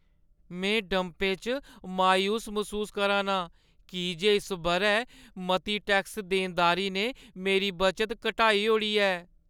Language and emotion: Dogri, sad